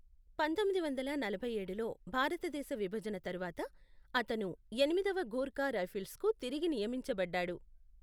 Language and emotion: Telugu, neutral